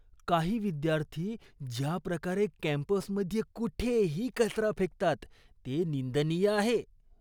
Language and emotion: Marathi, disgusted